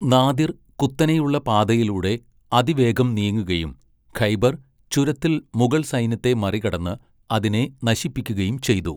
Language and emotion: Malayalam, neutral